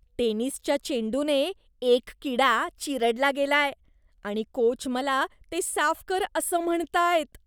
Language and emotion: Marathi, disgusted